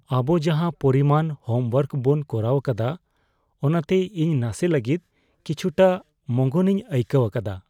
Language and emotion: Santali, fearful